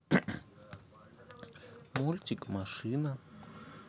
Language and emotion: Russian, neutral